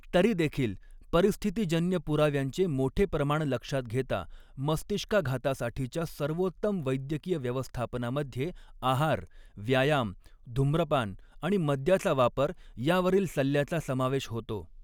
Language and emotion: Marathi, neutral